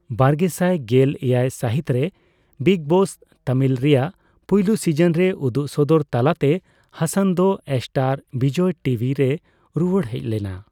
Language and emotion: Santali, neutral